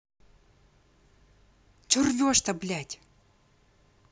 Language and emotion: Russian, angry